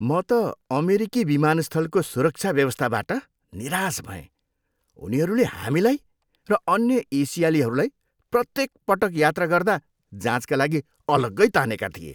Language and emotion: Nepali, disgusted